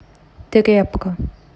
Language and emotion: Russian, neutral